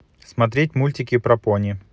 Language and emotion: Russian, neutral